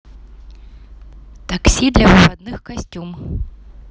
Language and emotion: Russian, neutral